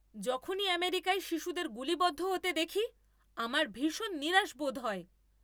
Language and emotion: Bengali, angry